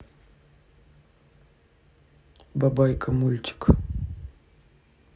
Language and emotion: Russian, neutral